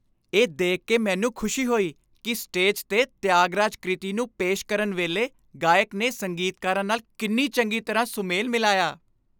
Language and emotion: Punjabi, happy